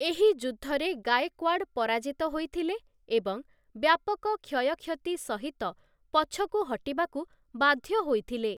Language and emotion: Odia, neutral